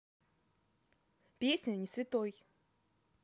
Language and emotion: Russian, neutral